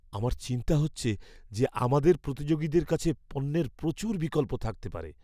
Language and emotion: Bengali, fearful